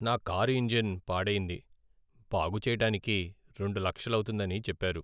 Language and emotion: Telugu, sad